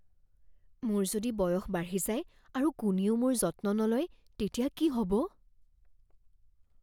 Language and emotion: Assamese, fearful